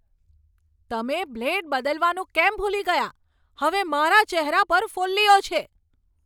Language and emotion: Gujarati, angry